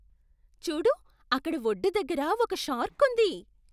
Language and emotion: Telugu, surprised